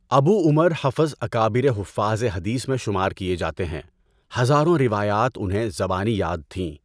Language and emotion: Urdu, neutral